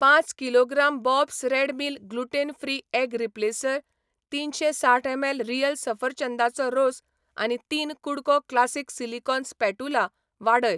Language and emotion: Goan Konkani, neutral